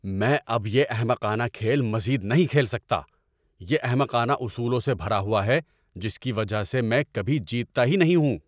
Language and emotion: Urdu, angry